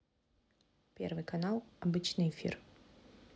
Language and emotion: Russian, neutral